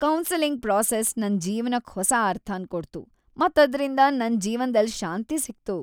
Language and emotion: Kannada, happy